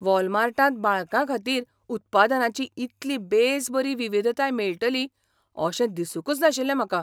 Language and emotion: Goan Konkani, surprised